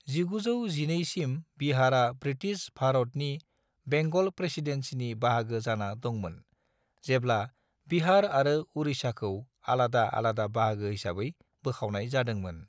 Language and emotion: Bodo, neutral